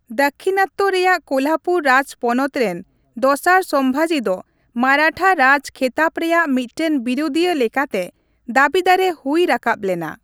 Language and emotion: Santali, neutral